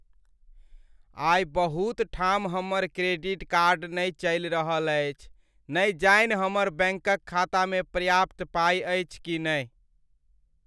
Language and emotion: Maithili, sad